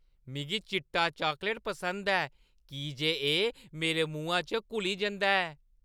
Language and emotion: Dogri, happy